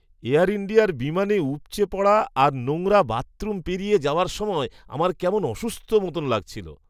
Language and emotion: Bengali, disgusted